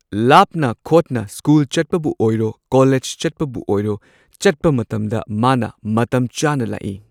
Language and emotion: Manipuri, neutral